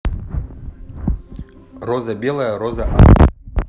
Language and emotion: Russian, neutral